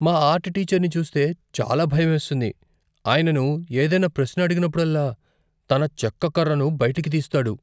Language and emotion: Telugu, fearful